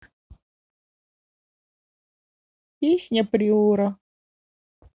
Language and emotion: Russian, sad